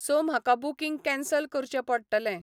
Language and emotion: Goan Konkani, neutral